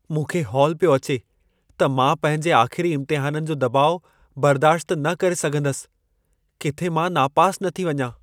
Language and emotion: Sindhi, fearful